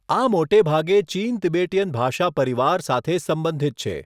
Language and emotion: Gujarati, neutral